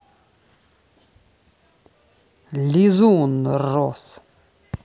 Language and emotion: Russian, neutral